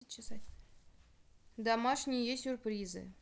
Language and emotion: Russian, neutral